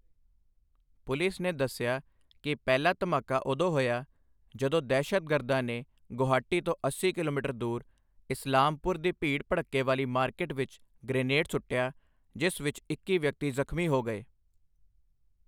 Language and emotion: Punjabi, neutral